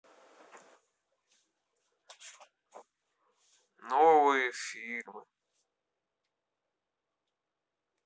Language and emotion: Russian, sad